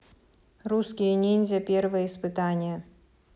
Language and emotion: Russian, neutral